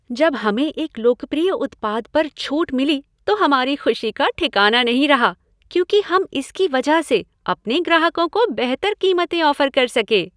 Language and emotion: Hindi, happy